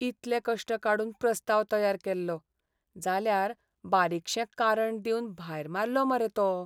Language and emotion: Goan Konkani, sad